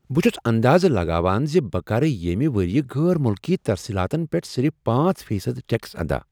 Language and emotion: Kashmiri, happy